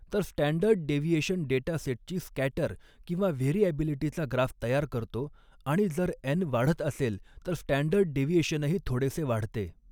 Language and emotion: Marathi, neutral